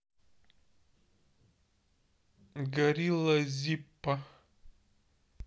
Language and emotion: Russian, neutral